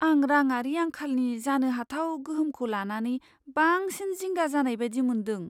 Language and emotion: Bodo, fearful